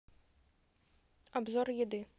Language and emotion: Russian, neutral